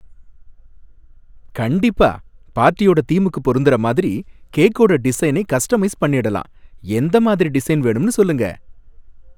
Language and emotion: Tamil, happy